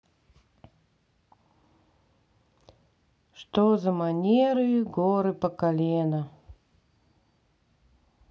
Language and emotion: Russian, sad